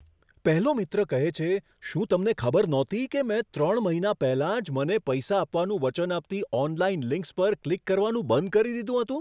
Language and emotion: Gujarati, surprised